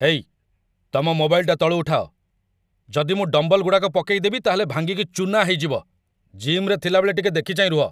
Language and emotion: Odia, angry